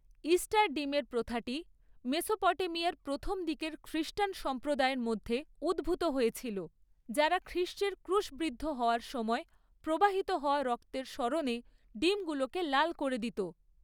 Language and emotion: Bengali, neutral